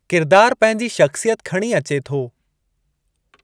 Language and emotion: Sindhi, neutral